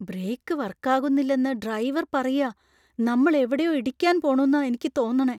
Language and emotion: Malayalam, fearful